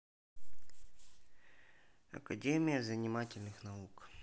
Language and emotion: Russian, neutral